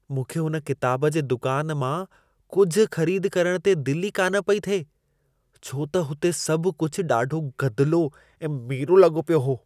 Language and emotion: Sindhi, disgusted